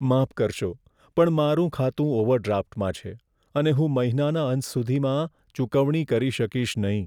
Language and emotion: Gujarati, sad